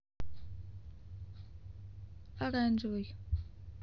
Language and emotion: Russian, neutral